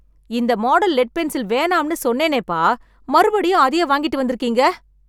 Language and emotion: Tamil, angry